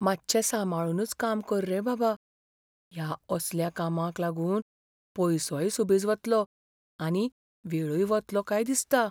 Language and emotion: Goan Konkani, fearful